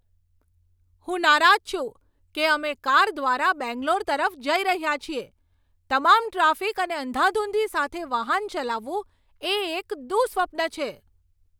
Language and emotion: Gujarati, angry